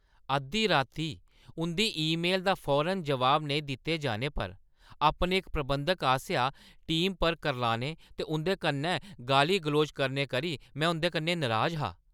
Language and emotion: Dogri, angry